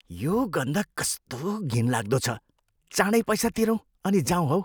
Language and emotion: Nepali, disgusted